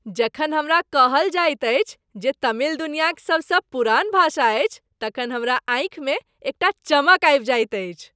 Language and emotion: Maithili, happy